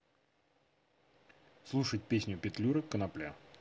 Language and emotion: Russian, neutral